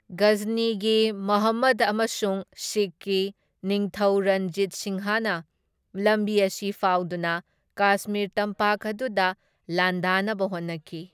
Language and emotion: Manipuri, neutral